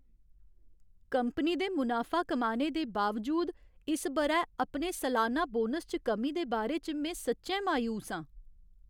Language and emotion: Dogri, sad